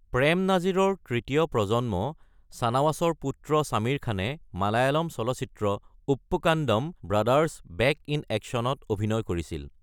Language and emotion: Assamese, neutral